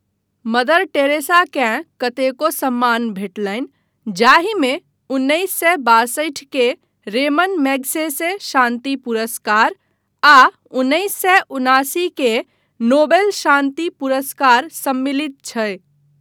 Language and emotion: Maithili, neutral